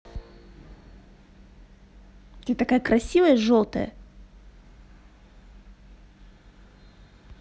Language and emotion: Russian, positive